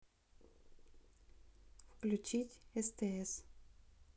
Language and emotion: Russian, neutral